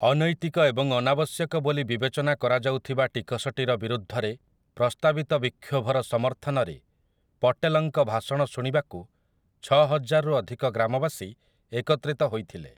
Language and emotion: Odia, neutral